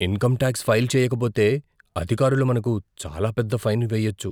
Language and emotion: Telugu, fearful